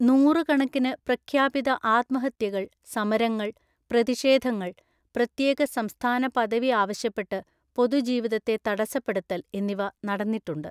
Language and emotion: Malayalam, neutral